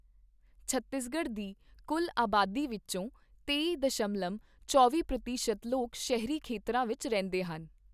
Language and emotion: Punjabi, neutral